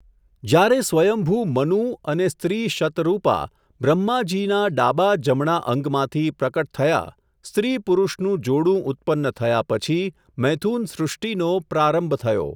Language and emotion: Gujarati, neutral